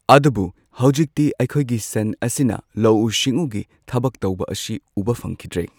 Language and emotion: Manipuri, neutral